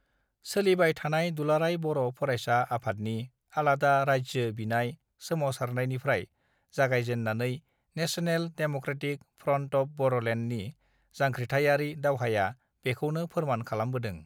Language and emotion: Bodo, neutral